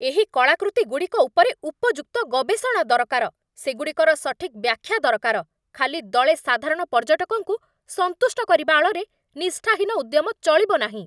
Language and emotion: Odia, angry